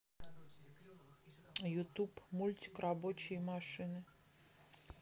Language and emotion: Russian, neutral